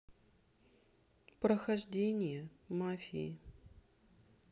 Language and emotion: Russian, sad